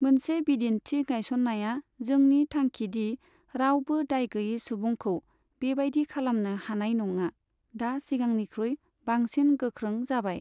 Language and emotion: Bodo, neutral